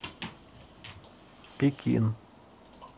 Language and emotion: Russian, neutral